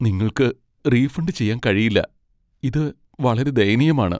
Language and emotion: Malayalam, sad